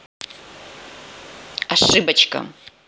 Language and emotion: Russian, angry